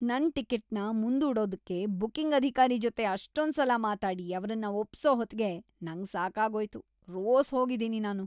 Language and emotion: Kannada, disgusted